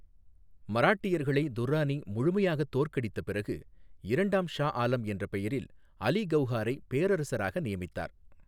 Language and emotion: Tamil, neutral